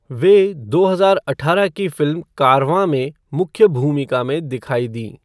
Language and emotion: Hindi, neutral